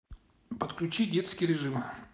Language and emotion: Russian, neutral